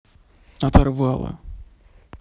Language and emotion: Russian, sad